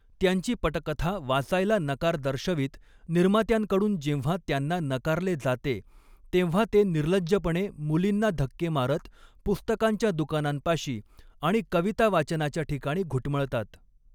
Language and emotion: Marathi, neutral